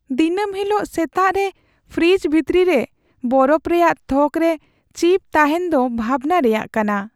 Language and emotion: Santali, sad